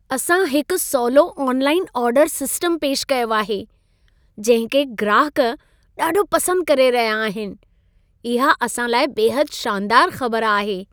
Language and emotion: Sindhi, happy